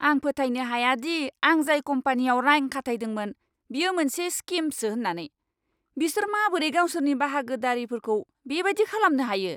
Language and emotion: Bodo, angry